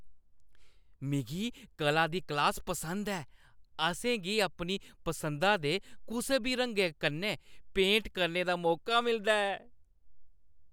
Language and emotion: Dogri, happy